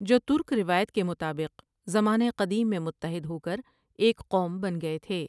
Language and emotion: Urdu, neutral